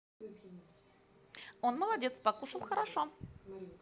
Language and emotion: Russian, positive